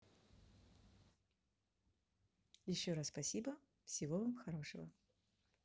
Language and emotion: Russian, positive